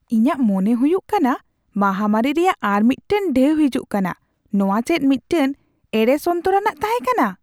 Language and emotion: Santali, surprised